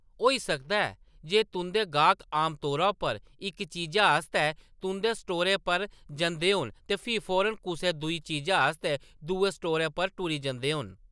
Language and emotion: Dogri, neutral